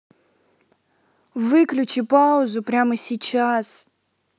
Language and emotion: Russian, angry